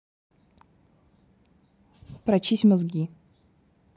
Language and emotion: Russian, angry